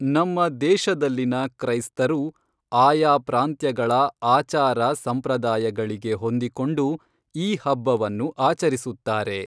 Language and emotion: Kannada, neutral